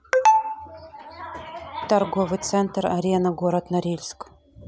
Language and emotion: Russian, neutral